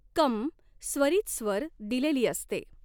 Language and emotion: Marathi, neutral